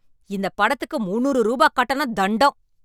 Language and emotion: Tamil, angry